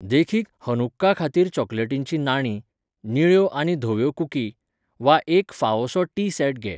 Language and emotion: Goan Konkani, neutral